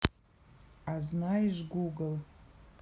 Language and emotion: Russian, neutral